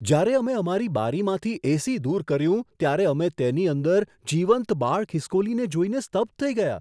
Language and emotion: Gujarati, surprised